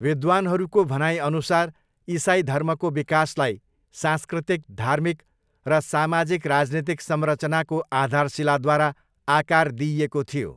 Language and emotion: Nepali, neutral